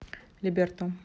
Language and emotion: Russian, neutral